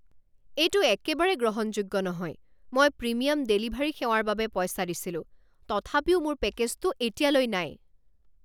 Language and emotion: Assamese, angry